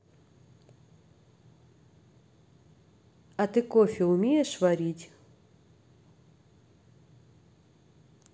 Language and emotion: Russian, neutral